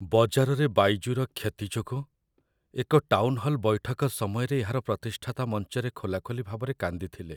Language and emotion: Odia, sad